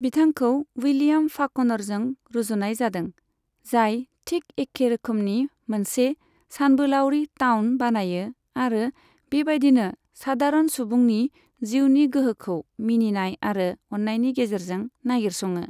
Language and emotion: Bodo, neutral